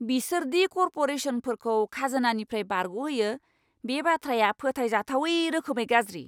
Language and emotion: Bodo, angry